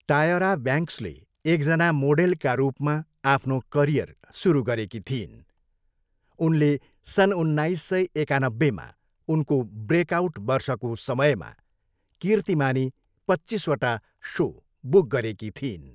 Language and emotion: Nepali, neutral